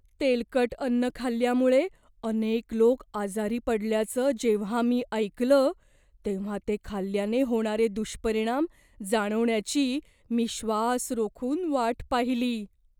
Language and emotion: Marathi, fearful